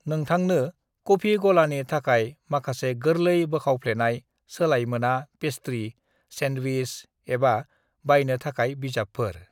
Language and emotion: Bodo, neutral